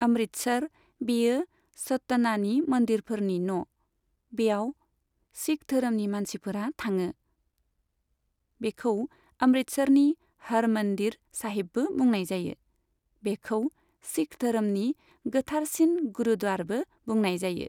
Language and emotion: Bodo, neutral